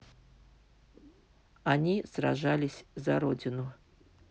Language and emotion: Russian, neutral